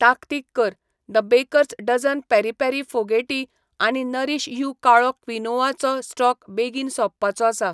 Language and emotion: Goan Konkani, neutral